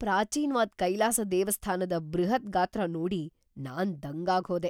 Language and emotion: Kannada, surprised